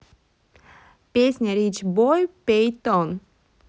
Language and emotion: Russian, neutral